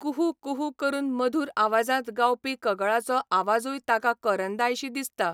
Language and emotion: Goan Konkani, neutral